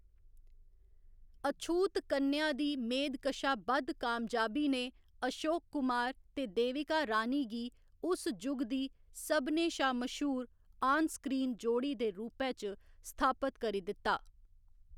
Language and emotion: Dogri, neutral